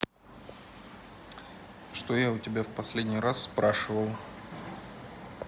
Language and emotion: Russian, neutral